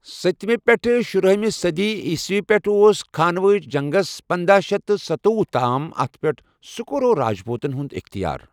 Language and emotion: Kashmiri, neutral